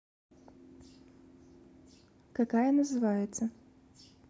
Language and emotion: Russian, neutral